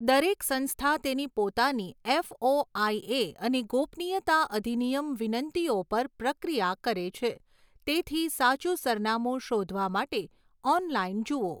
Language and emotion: Gujarati, neutral